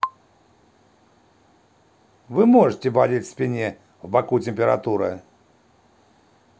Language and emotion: Russian, neutral